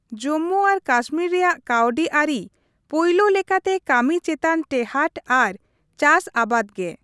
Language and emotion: Santali, neutral